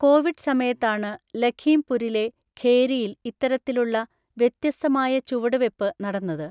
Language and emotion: Malayalam, neutral